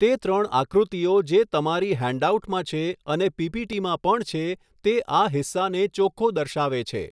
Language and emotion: Gujarati, neutral